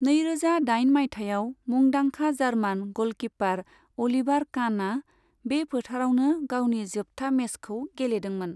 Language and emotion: Bodo, neutral